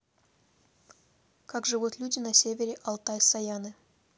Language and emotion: Russian, neutral